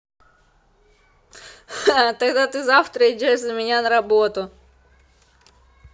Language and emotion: Russian, positive